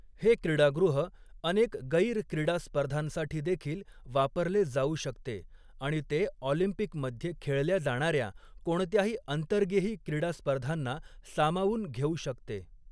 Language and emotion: Marathi, neutral